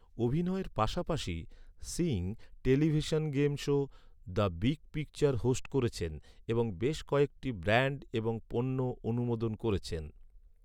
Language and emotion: Bengali, neutral